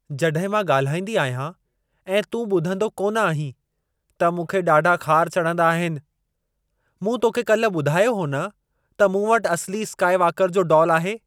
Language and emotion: Sindhi, angry